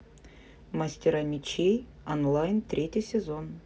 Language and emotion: Russian, neutral